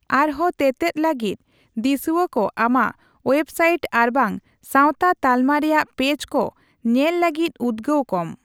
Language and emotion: Santali, neutral